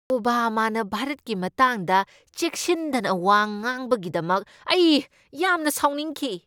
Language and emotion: Manipuri, angry